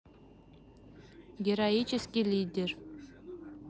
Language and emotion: Russian, neutral